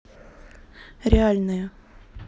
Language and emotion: Russian, neutral